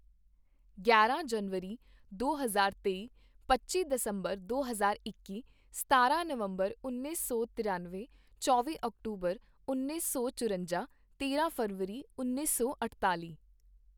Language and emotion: Punjabi, neutral